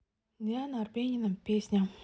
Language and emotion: Russian, neutral